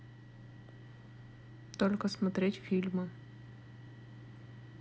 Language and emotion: Russian, neutral